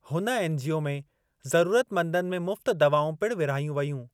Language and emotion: Sindhi, neutral